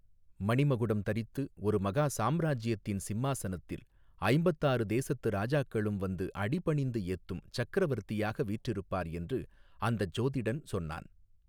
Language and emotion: Tamil, neutral